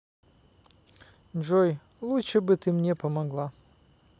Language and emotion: Russian, neutral